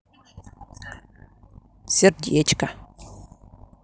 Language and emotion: Russian, positive